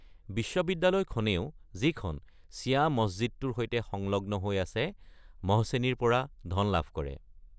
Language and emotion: Assamese, neutral